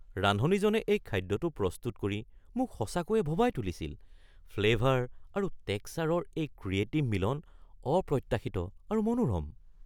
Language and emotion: Assamese, surprised